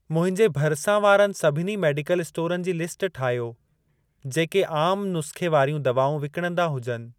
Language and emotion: Sindhi, neutral